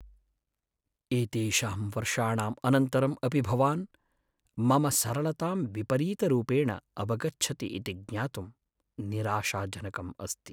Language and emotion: Sanskrit, sad